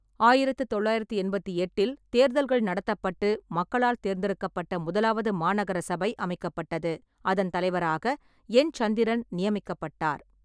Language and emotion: Tamil, neutral